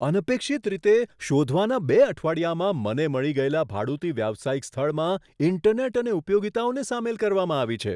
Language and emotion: Gujarati, surprised